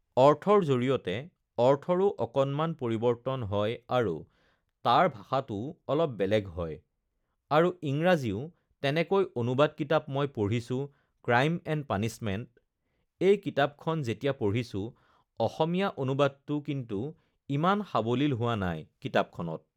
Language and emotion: Assamese, neutral